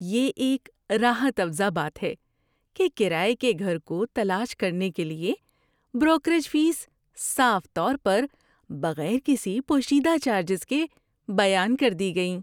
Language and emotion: Urdu, happy